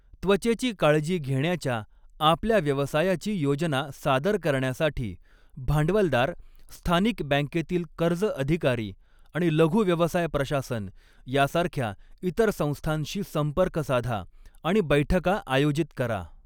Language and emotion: Marathi, neutral